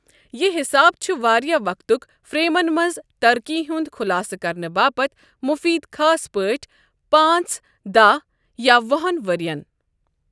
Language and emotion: Kashmiri, neutral